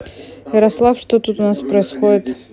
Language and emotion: Russian, neutral